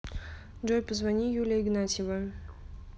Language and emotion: Russian, neutral